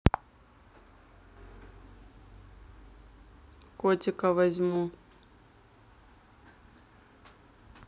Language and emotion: Russian, neutral